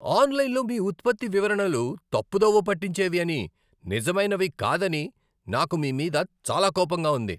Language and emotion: Telugu, angry